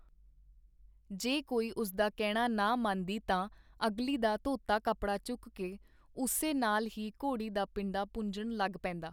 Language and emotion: Punjabi, neutral